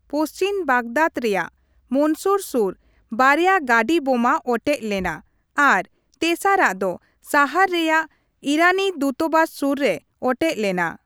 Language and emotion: Santali, neutral